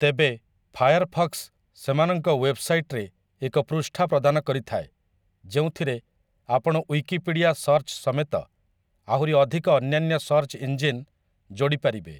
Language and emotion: Odia, neutral